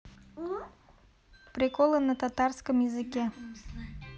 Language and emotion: Russian, neutral